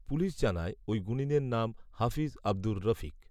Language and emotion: Bengali, neutral